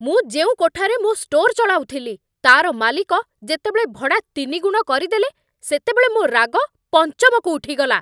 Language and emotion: Odia, angry